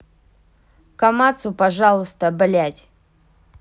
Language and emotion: Russian, angry